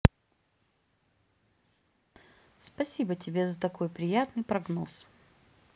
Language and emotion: Russian, neutral